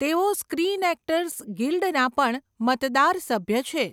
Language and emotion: Gujarati, neutral